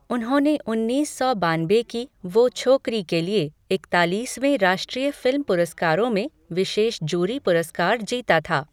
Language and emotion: Hindi, neutral